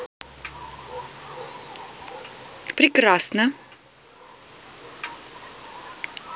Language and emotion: Russian, positive